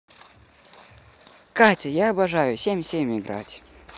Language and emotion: Russian, positive